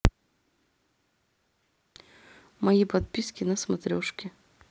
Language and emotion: Russian, neutral